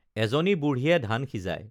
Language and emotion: Assamese, neutral